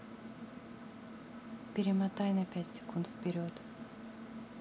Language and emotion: Russian, neutral